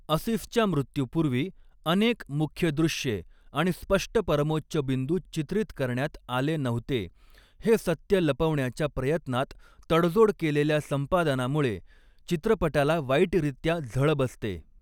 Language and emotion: Marathi, neutral